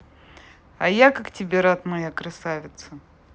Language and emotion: Russian, positive